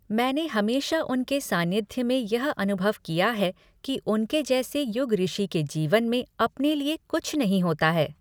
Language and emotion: Hindi, neutral